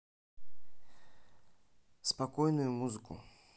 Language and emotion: Russian, neutral